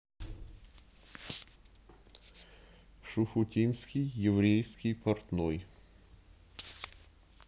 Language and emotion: Russian, neutral